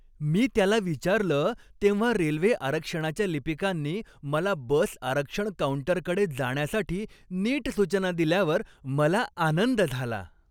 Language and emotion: Marathi, happy